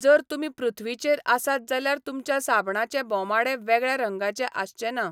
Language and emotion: Goan Konkani, neutral